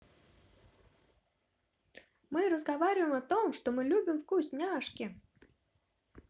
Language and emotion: Russian, positive